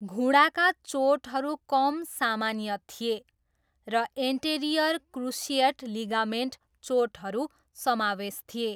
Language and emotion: Nepali, neutral